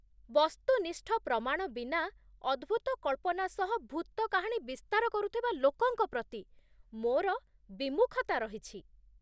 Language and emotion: Odia, disgusted